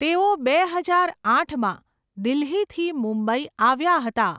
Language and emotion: Gujarati, neutral